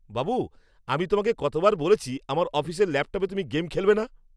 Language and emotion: Bengali, angry